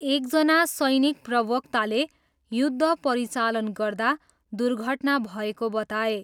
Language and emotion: Nepali, neutral